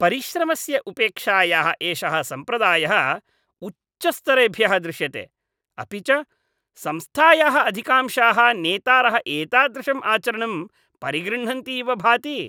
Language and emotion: Sanskrit, disgusted